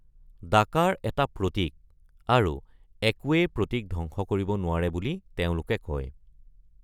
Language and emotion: Assamese, neutral